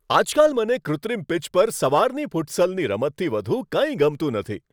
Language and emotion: Gujarati, happy